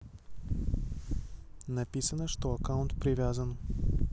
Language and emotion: Russian, neutral